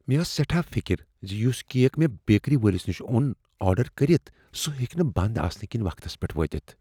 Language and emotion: Kashmiri, fearful